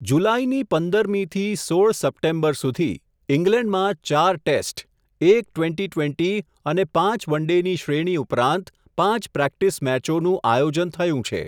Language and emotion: Gujarati, neutral